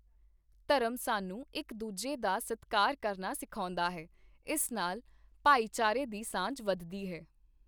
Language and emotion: Punjabi, neutral